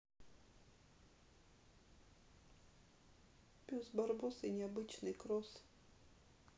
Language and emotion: Russian, sad